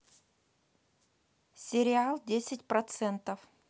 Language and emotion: Russian, neutral